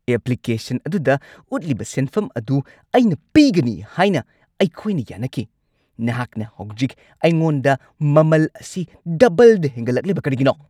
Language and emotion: Manipuri, angry